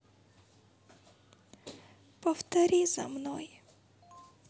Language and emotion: Russian, sad